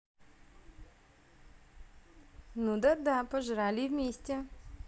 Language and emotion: Russian, positive